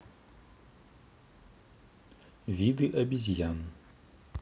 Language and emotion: Russian, neutral